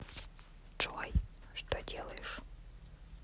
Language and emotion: Russian, neutral